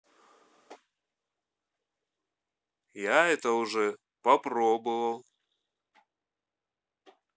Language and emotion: Russian, neutral